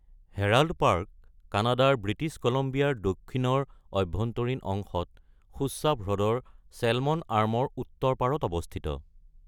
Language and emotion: Assamese, neutral